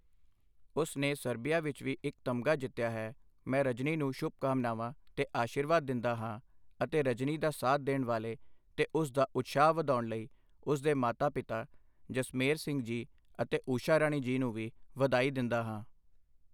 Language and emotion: Punjabi, neutral